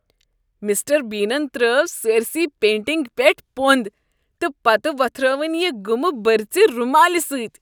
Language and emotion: Kashmiri, disgusted